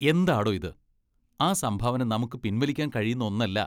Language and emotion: Malayalam, disgusted